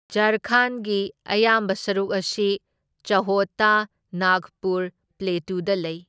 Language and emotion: Manipuri, neutral